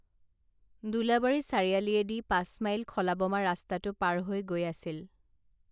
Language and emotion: Assamese, neutral